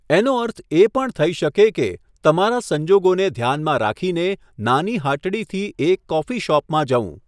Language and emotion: Gujarati, neutral